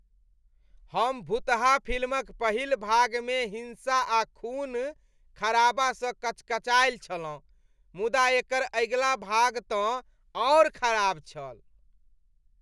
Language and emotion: Maithili, disgusted